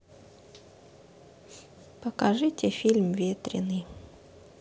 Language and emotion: Russian, sad